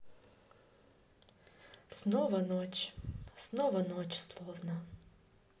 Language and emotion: Russian, sad